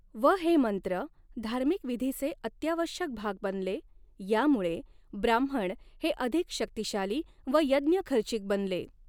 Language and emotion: Marathi, neutral